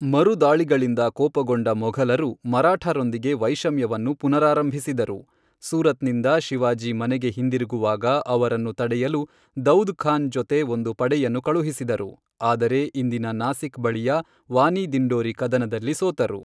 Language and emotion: Kannada, neutral